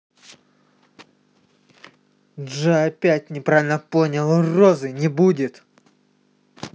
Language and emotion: Russian, angry